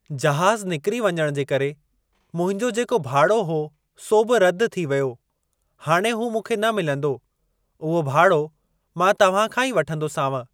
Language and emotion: Sindhi, neutral